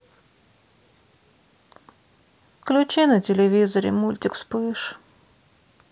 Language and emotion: Russian, sad